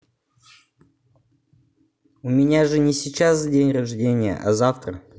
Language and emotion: Russian, neutral